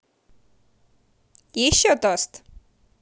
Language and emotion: Russian, positive